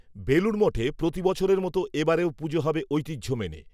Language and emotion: Bengali, neutral